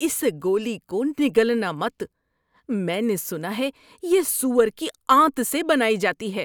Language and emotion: Urdu, disgusted